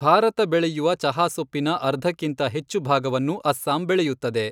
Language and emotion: Kannada, neutral